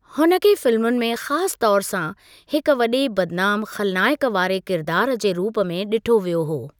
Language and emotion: Sindhi, neutral